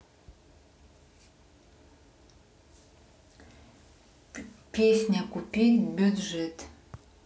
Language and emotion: Russian, neutral